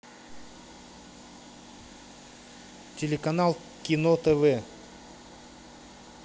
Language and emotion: Russian, neutral